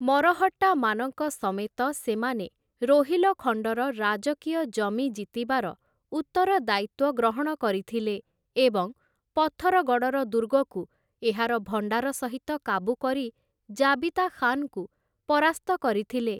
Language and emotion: Odia, neutral